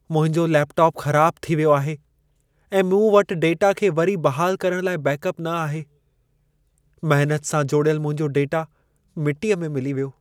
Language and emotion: Sindhi, sad